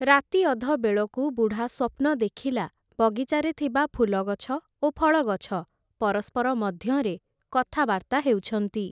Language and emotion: Odia, neutral